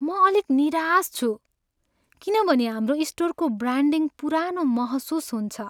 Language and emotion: Nepali, sad